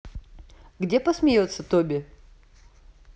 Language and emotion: Russian, neutral